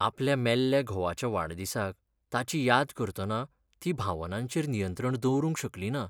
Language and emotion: Goan Konkani, sad